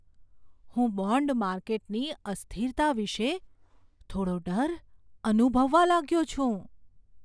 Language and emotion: Gujarati, fearful